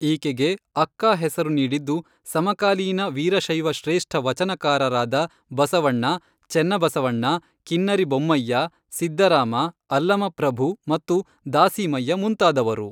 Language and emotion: Kannada, neutral